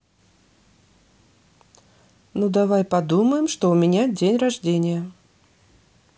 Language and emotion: Russian, neutral